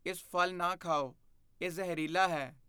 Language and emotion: Punjabi, fearful